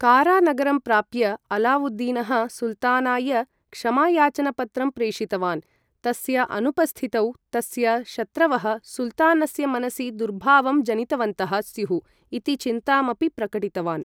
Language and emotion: Sanskrit, neutral